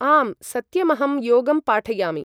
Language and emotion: Sanskrit, neutral